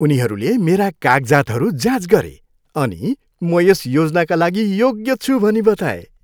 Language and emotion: Nepali, happy